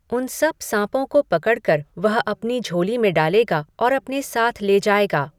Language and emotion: Hindi, neutral